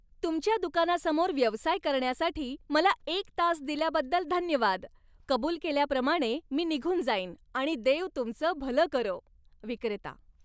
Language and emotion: Marathi, happy